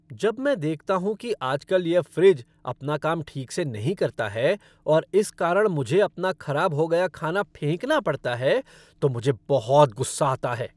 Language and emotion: Hindi, angry